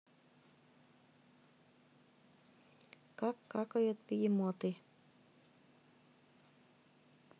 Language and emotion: Russian, neutral